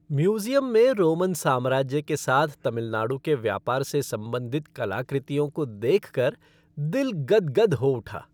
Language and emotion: Hindi, happy